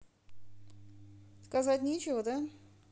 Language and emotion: Russian, neutral